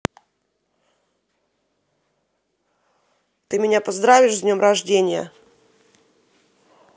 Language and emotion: Russian, angry